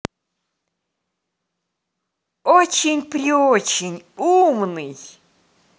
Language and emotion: Russian, positive